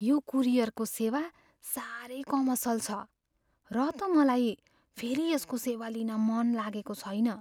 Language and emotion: Nepali, fearful